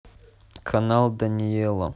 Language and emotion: Russian, neutral